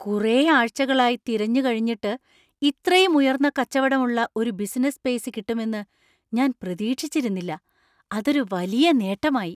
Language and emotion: Malayalam, surprised